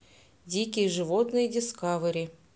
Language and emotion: Russian, neutral